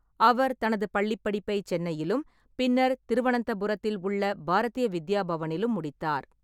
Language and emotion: Tamil, neutral